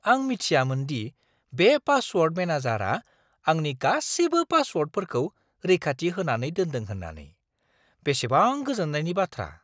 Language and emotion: Bodo, surprised